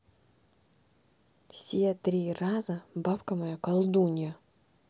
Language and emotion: Russian, neutral